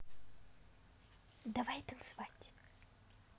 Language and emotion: Russian, positive